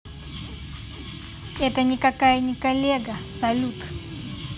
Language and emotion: Russian, neutral